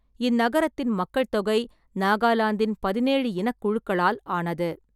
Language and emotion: Tamil, neutral